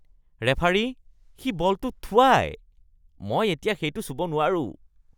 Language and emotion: Assamese, disgusted